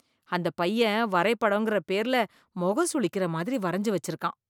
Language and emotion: Tamil, disgusted